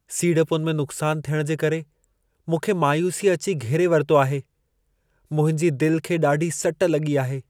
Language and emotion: Sindhi, sad